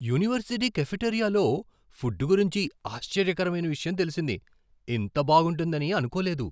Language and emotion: Telugu, surprised